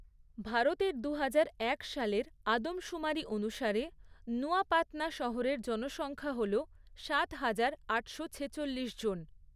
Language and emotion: Bengali, neutral